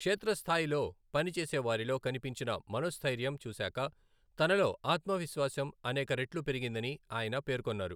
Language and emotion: Telugu, neutral